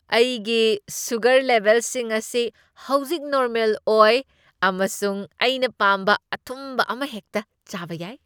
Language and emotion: Manipuri, happy